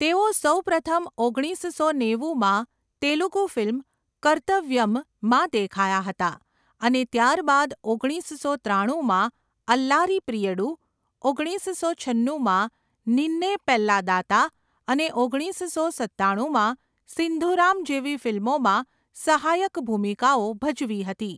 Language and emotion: Gujarati, neutral